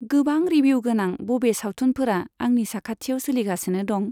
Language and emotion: Bodo, neutral